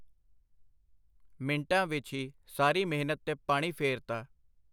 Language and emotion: Punjabi, neutral